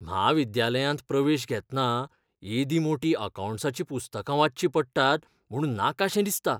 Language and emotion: Goan Konkani, fearful